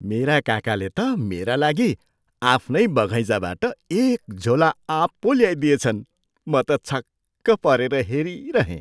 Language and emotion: Nepali, surprised